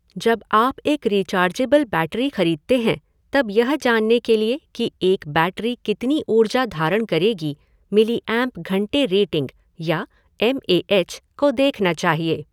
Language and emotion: Hindi, neutral